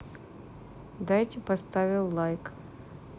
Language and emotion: Russian, neutral